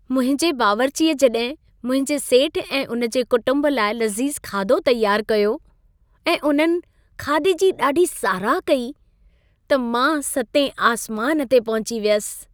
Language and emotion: Sindhi, happy